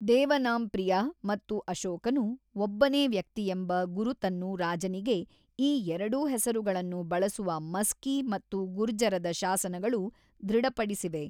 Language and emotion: Kannada, neutral